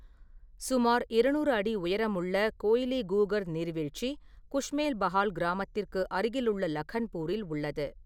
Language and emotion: Tamil, neutral